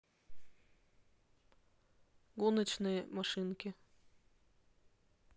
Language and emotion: Russian, neutral